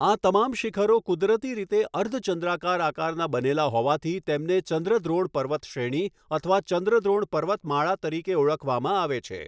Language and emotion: Gujarati, neutral